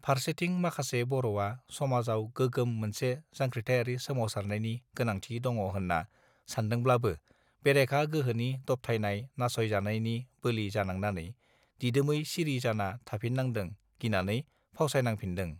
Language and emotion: Bodo, neutral